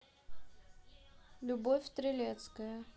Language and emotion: Russian, neutral